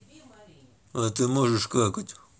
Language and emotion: Russian, neutral